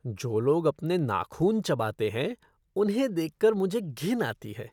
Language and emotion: Hindi, disgusted